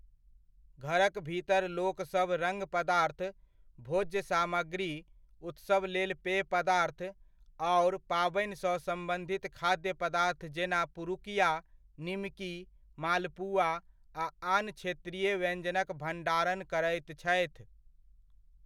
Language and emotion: Maithili, neutral